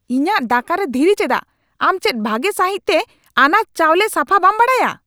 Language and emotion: Santali, angry